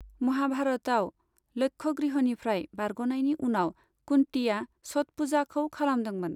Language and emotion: Bodo, neutral